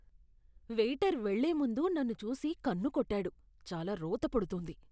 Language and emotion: Telugu, disgusted